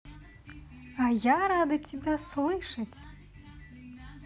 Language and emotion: Russian, positive